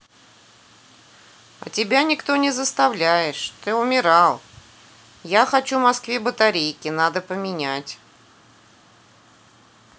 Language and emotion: Russian, neutral